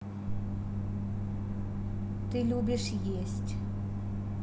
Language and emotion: Russian, neutral